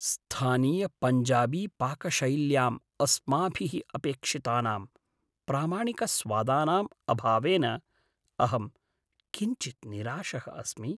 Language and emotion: Sanskrit, sad